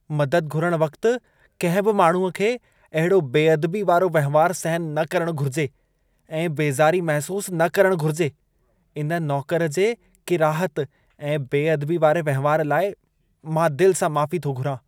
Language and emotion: Sindhi, disgusted